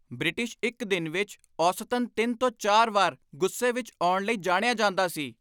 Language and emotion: Punjabi, angry